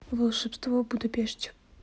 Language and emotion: Russian, neutral